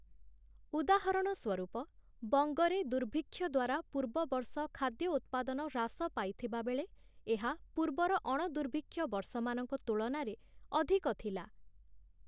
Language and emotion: Odia, neutral